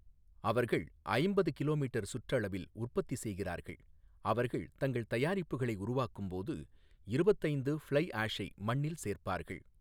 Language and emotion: Tamil, neutral